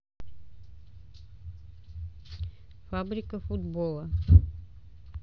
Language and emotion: Russian, neutral